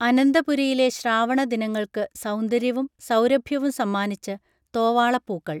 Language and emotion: Malayalam, neutral